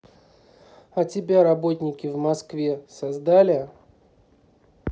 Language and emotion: Russian, neutral